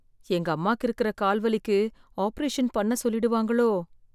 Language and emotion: Tamil, fearful